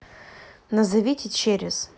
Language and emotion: Russian, neutral